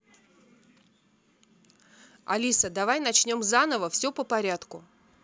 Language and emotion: Russian, neutral